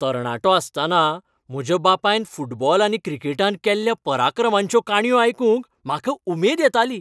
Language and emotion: Goan Konkani, happy